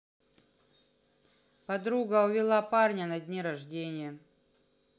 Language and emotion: Russian, neutral